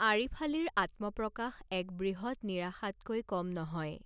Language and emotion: Assamese, neutral